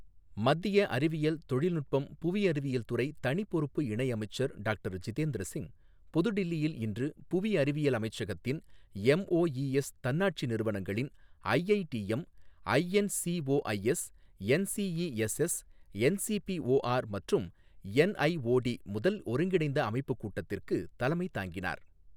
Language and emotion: Tamil, neutral